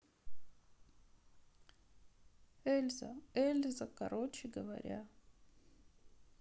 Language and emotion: Russian, sad